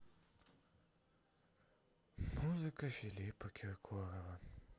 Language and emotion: Russian, sad